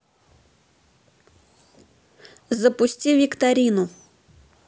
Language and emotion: Russian, neutral